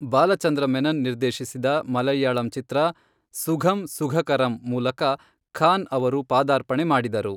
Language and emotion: Kannada, neutral